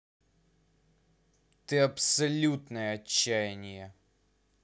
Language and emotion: Russian, angry